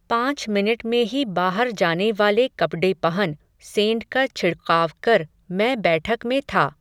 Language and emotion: Hindi, neutral